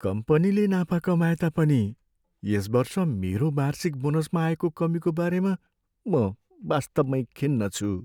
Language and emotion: Nepali, sad